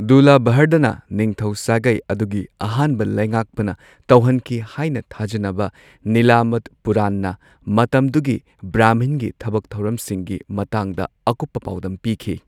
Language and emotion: Manipuri, neutral